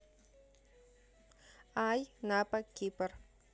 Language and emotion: Russian, neutral